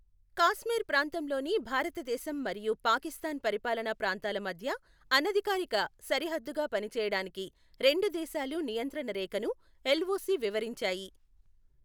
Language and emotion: Telugu, neutral